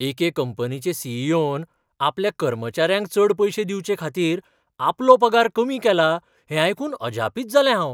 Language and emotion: Goan Konkani, surprised